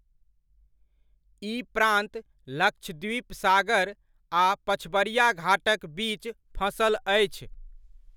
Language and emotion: Maithili, neutral